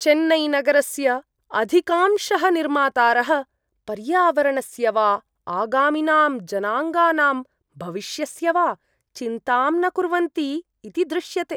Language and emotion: Sanskrit, disgusted